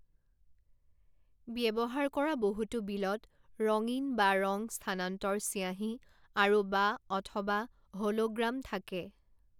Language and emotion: Assamese, neutral